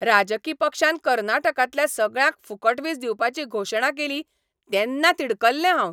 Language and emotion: Goan Konkani, angry